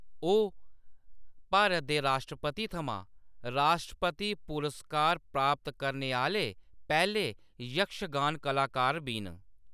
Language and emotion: Dogri, neutral